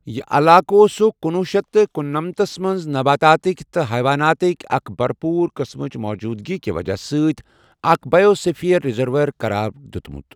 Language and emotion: Kashmiri, neutral